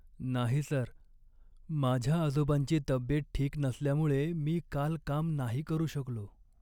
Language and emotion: Marathi, sad